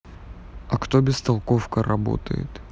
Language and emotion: Russian, neutral